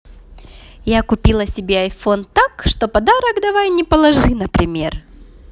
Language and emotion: Russian, positive